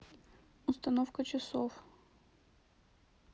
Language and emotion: Russian, sad